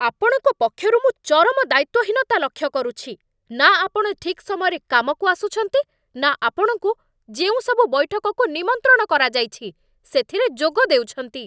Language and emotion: Odia, angry